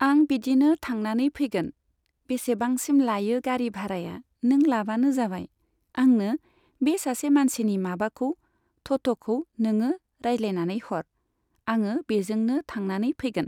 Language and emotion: Bodo, neutral